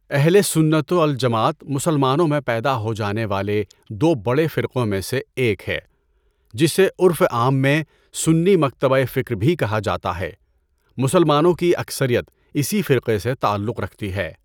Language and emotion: Urdu, neutral